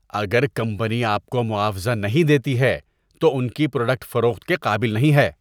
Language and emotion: Urdu, disgusted